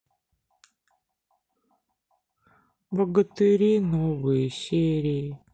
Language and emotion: Russian, sad